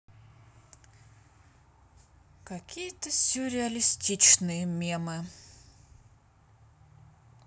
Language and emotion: Russian, sad